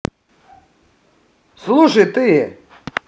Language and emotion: Russian, angry